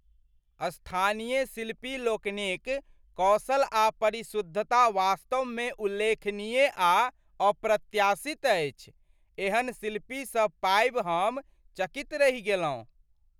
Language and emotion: Maithili, surprised